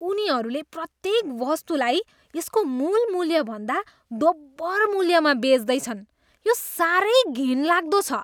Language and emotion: Nepali, disgusted